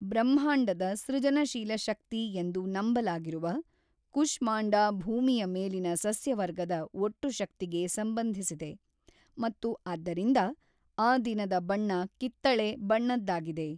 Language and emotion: Kannada, neutral